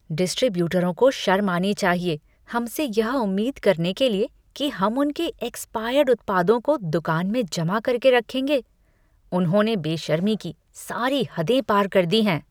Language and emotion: Hindi, disgusted